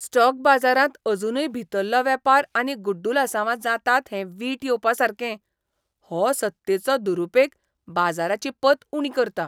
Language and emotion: Goan Konkani, disgusted